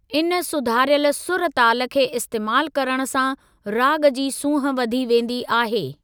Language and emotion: Sindhi, neutral